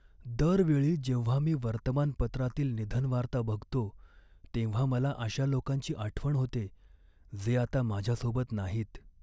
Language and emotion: Marathi, sad